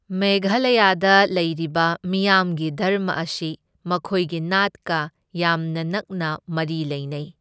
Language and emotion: Manipuri, neutral